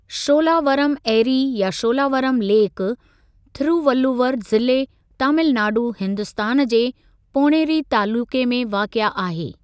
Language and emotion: Sindhi, neutral